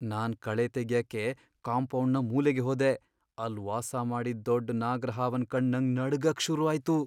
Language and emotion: Kannada, fearful